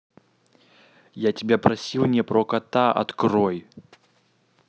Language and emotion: Russian, angry